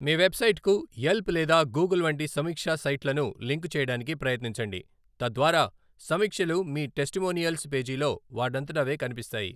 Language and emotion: Telugu, neutral